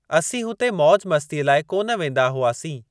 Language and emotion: Sindhi, neutral